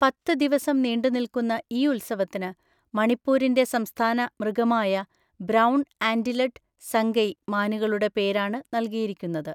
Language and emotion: Malayalam, neutral